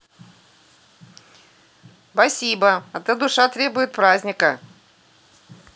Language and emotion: Russian, positive